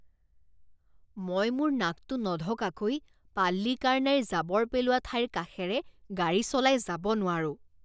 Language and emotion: Assamese, disgusted